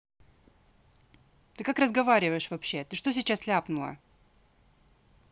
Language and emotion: Russian, angry